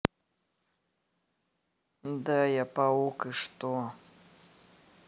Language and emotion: Russian, neutral